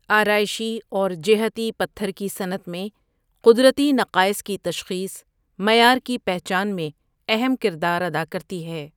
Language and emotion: Urdu, neutral